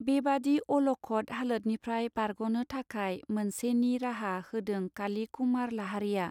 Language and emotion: Bodo, neutral